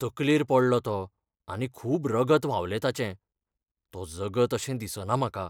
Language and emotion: Goan Konkani, fearful